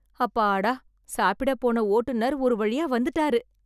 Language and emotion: Tamil, happy